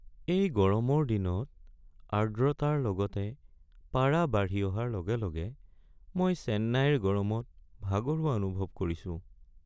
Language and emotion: Assamese, sad